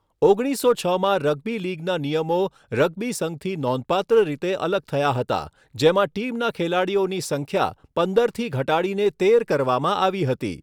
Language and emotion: Gujarati, neutral